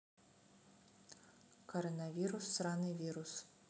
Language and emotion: Russian, neutral